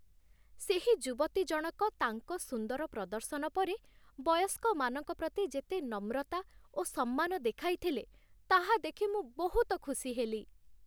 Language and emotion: Odia, happy